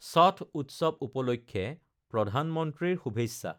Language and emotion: Assamese, neutral